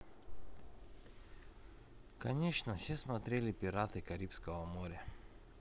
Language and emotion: Russian, neutral